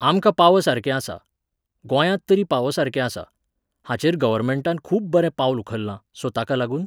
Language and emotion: Goan Konkani, neutral